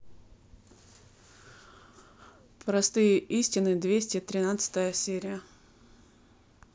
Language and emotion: Russian, neutral